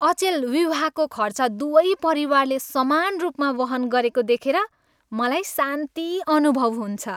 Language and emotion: Nepali, happy